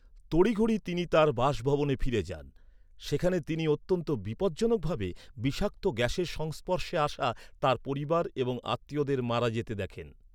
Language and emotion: Bengali, neutral